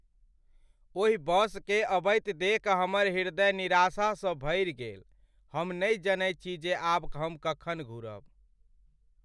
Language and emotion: Maithili, sad